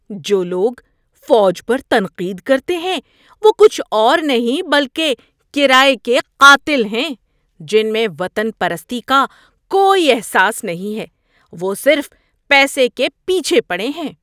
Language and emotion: Urdu, disgusted